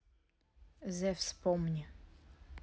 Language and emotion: Russian, neutral